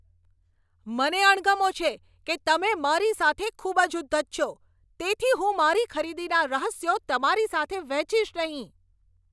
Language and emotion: Gujarati, angry